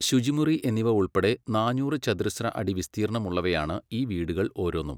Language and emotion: Malayalam, neutral